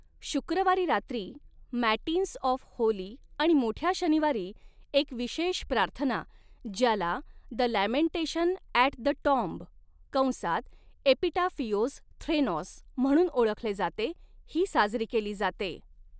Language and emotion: Marathi, neutral